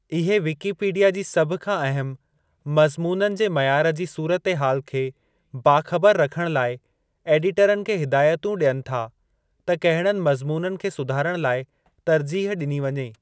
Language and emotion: Sindhi, neutral